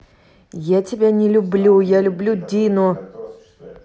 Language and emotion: Russian, angry